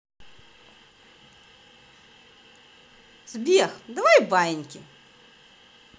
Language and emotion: Russian, positive